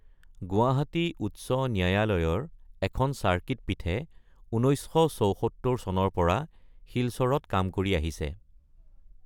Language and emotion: Assamese, neutral